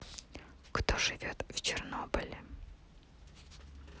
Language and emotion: Russian, neutral